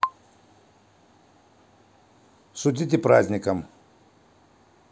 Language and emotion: Russian, neutral